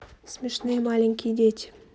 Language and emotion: Russian, neutral